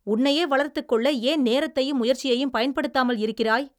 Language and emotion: Tamil, angry